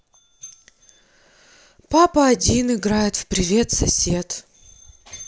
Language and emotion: Russian, sad